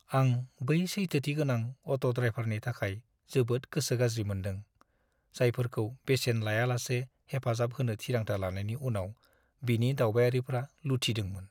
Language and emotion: Bodo, sad